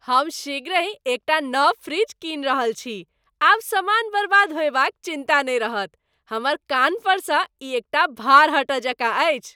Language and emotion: Maithili, happy